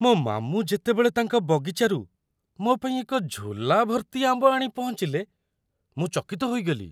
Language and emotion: Odia, surprised